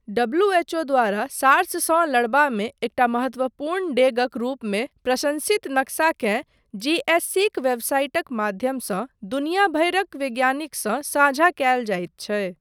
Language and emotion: Maithili, neutral